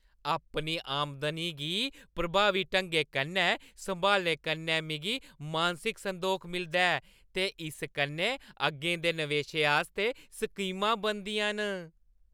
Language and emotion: Dogri, happy